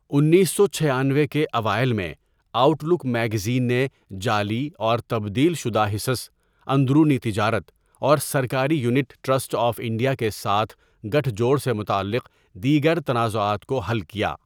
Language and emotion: Urdu, neutral